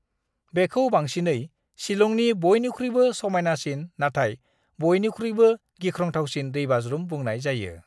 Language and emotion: Bodo, neutral